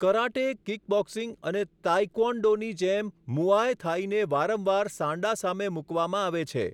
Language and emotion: Gujarati, neutral